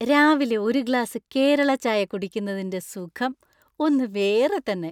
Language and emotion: Malayalam, happy